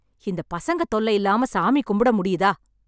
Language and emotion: Tamil, angry